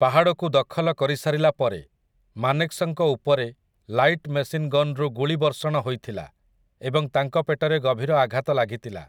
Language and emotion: Odia, neutral